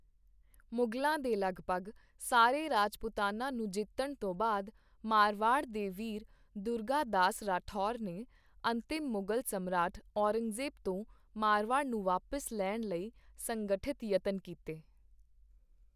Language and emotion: Punjabi, neutral